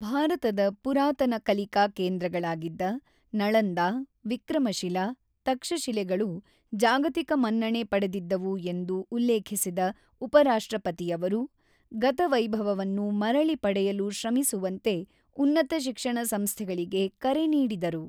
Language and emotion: Kannada, neutral